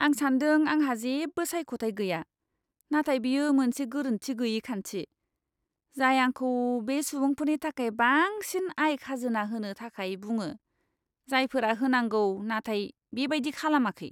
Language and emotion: Bodo, disgusted